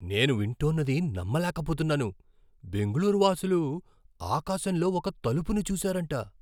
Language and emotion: Telugu, surprised